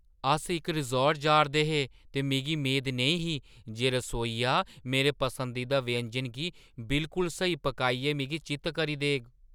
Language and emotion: Dogri, surprised